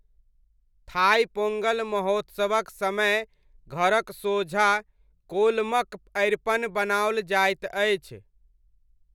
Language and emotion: Maithili, neutral